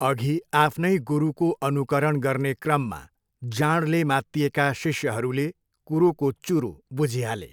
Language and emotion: Nepali, neutral